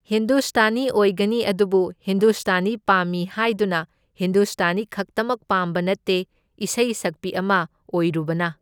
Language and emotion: Manipuri, neutral